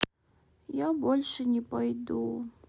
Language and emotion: Russian, sad